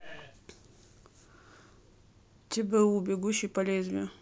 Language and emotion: Russian, neutral